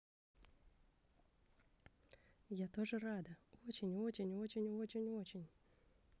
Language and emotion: Russian, positive